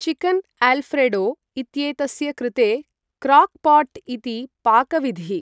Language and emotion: Sanskrit, neutral